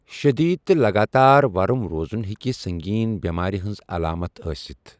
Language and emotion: Kashmiri, neutral